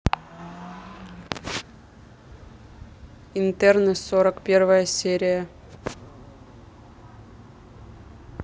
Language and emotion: Russian, neutral